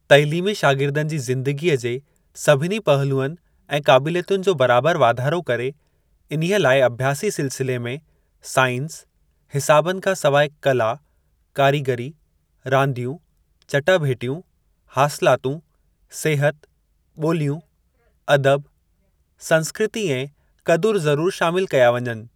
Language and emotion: Sindhi, neutral